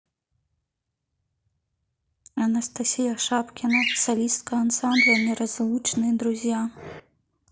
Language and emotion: Russian, neutral